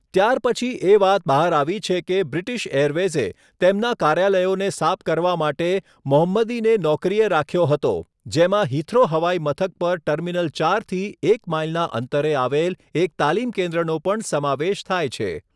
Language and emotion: Gujarati, neutral